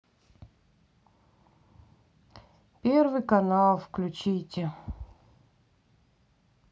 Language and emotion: Russian, sad